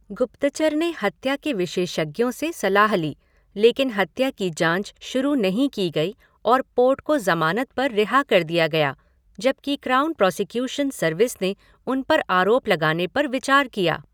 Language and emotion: Hindi, neutral